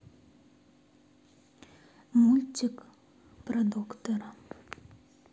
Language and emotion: Russian, sad